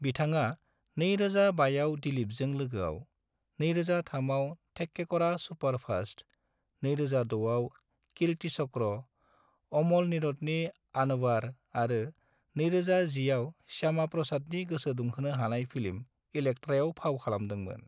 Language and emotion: Bodo, neutral